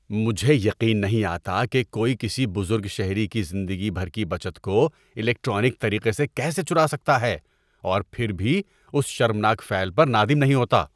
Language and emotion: Urdu, disgusted